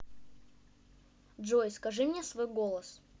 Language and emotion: Russian, neutral